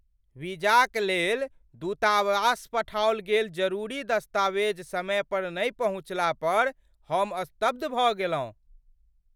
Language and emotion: Maithili, surprised